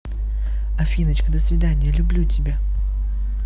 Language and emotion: Russian, positive